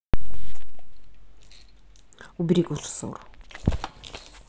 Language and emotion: Russian, neutral